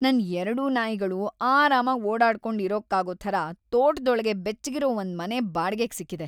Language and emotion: Kannada, happy